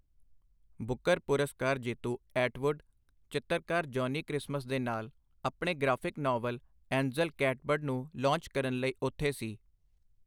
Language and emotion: Punjabi, neutral